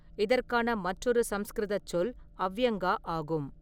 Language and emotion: Tamil, neutral